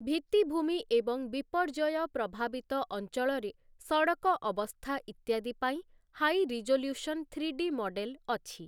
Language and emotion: Odia, neutral